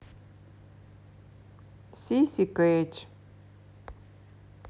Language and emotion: Russian, sad